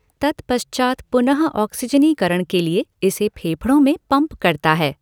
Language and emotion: Hindi, neutral